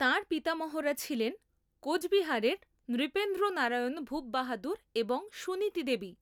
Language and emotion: Bengali, neutral